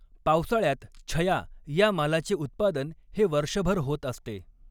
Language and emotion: Marathi, neutral